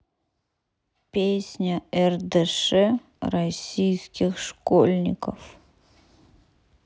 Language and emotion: Russian, sad